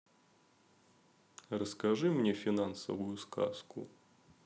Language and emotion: Russian, neutral